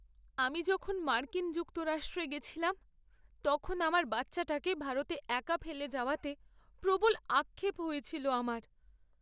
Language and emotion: Bengali, sad